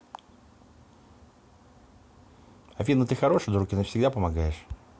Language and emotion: Russian, neutral